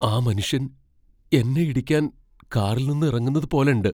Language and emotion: Malayalam, fearful